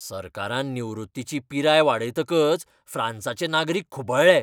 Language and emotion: Goan Konkani, angry